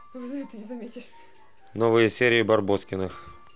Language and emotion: Russian, neutral